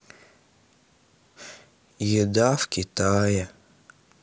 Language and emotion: Russian, sad